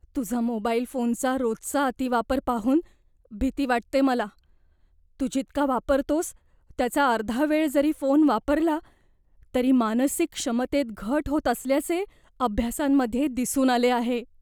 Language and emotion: Marathi, fearful